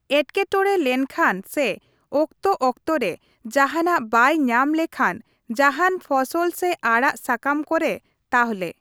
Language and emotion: Santali, neutral